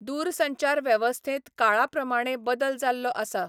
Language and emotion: Goan Konkani, neutral